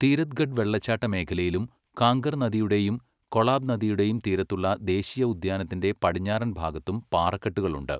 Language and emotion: Malayalam, neutral